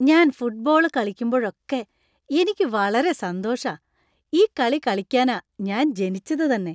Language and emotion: Malayalam, happy